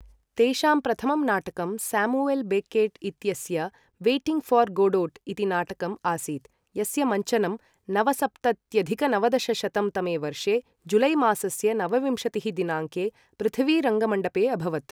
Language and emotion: Sanskrit, neutral